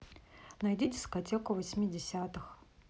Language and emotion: Russian, neutral